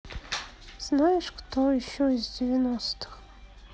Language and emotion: Russian, sad